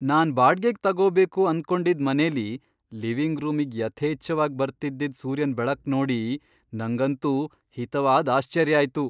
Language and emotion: Kannada, surprised